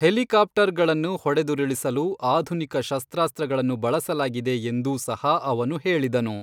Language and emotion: Kannada, neutral